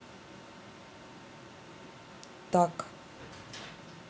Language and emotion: Russian, neutral